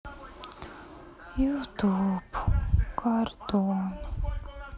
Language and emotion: Russian, sad